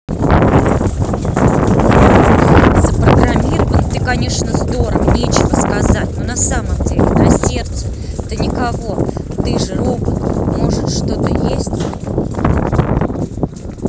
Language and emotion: Russian, angry